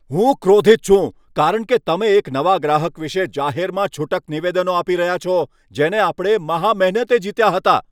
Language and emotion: Gujarati, angry